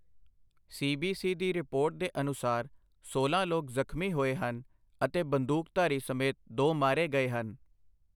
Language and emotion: Punjabi, neutral